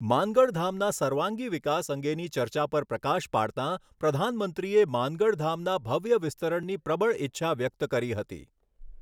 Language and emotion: Gujarati, neutral